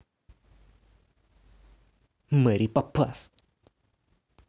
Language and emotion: Russian, angry